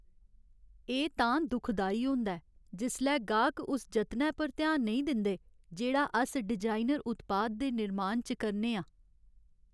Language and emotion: Dogri, sad